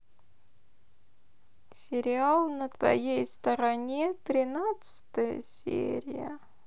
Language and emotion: Russian, sad